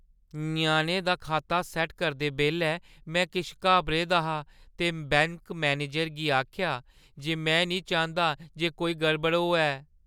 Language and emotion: Dogri, fearful